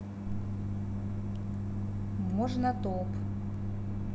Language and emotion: Russian, neutral